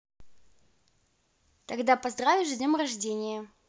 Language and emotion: Russian, positive